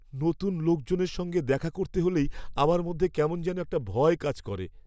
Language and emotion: Bengali, fearful